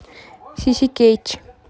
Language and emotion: Russian, neutral